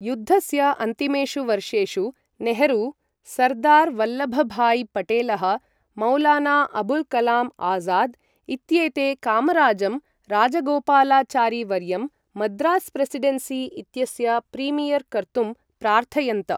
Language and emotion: Sanskrit, neutral